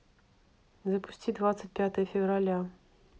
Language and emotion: Russian, neutral